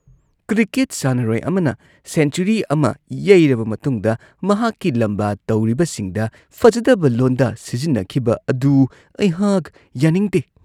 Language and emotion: Manipuri, disgusted